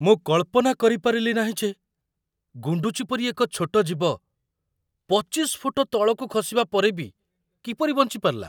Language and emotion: Odia, surprised